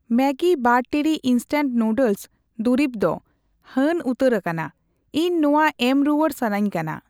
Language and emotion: Santali, neutral